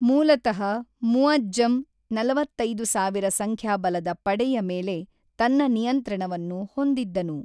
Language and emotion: Kannada, neutral